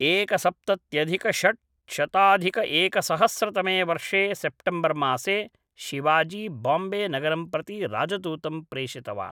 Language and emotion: Sanskrit, neutral